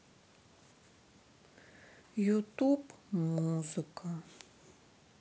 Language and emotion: Russian, sad